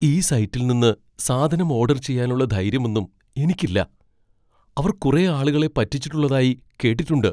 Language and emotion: Malayalam, fearful